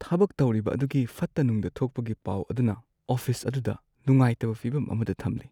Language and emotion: Manipuri, sad